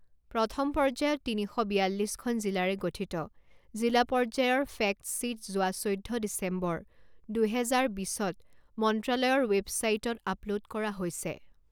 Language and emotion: Assamese, neutral